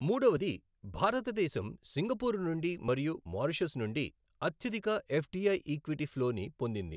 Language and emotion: Telugu, neutral